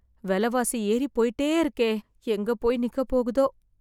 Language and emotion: Tamil, fearful